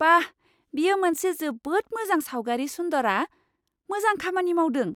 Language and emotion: Bodo, surprised